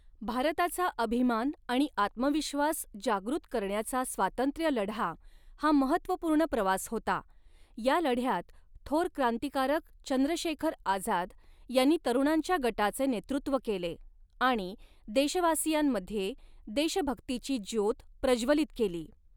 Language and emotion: Marathi, neutral